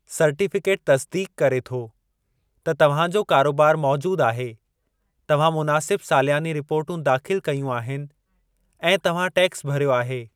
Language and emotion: Sindhi, neutral